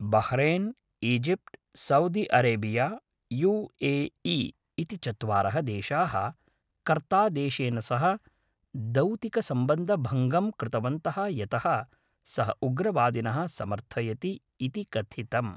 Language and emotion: Sanskrit, neutral